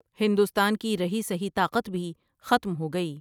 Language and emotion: Urdu, neutral